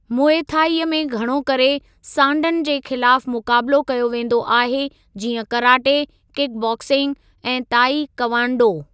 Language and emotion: Sindhi, neutral